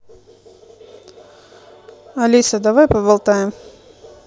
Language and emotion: Russian, neutral